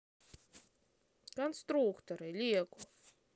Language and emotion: Russian, neutral